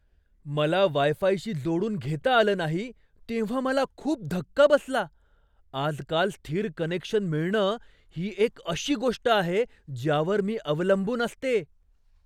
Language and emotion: Marathi, surprised